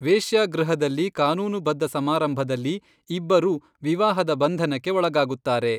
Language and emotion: Kannada, neutral